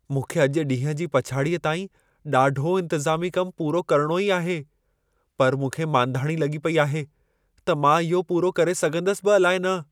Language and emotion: Sindhi, fearful